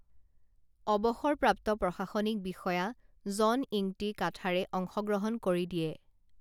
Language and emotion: Assamese, neutral